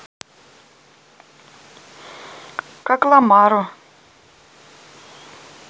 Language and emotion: Russian, neutral